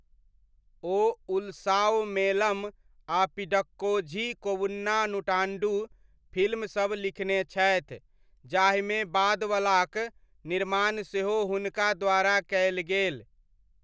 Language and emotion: Maithili, neutral